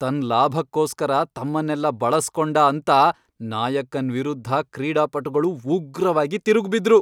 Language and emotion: Kannada, angry